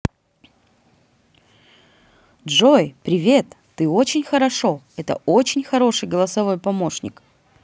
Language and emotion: Russian, positive